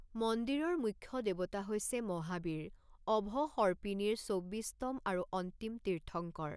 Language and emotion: Assamese, neutral